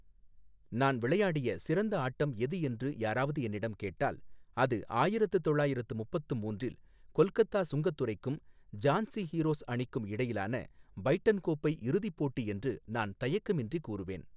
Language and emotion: Tamil, neutral